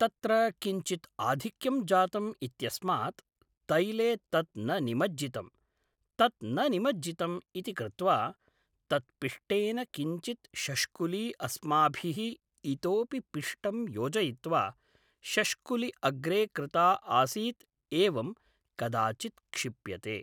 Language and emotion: Sanskrit, neutral